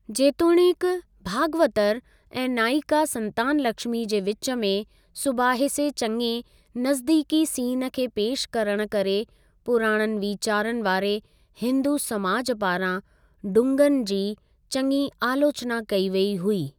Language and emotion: Sindhi, neutral